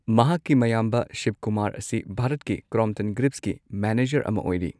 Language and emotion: Manipuri, neutral